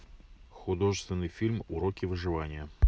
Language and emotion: Russian, neutral